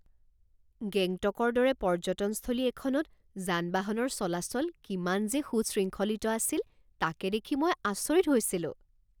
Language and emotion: Assamese, surprised